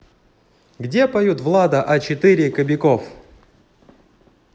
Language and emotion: Russian, positive